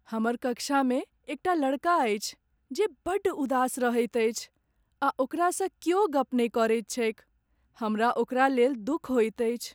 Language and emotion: Maithili, sad